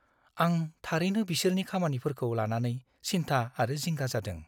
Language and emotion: Bodo, fearful